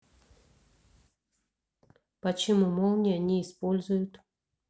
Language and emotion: Russian, neutral